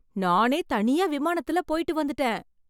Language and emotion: Tamil, surprised